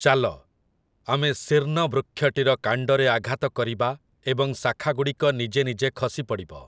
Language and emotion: Odia, neutral